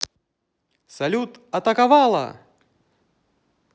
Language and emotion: Russian, positive